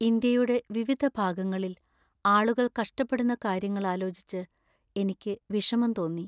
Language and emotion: Malayalam, sad